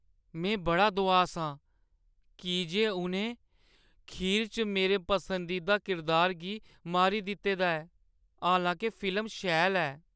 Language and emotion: Dogri, sad